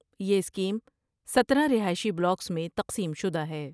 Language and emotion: Urdu, neutral